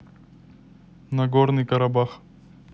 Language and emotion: Russian, neutral